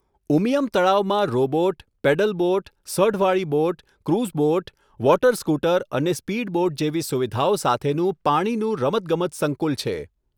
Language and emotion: Gujarati, neutral